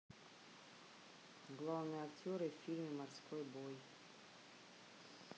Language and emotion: Russian, neutral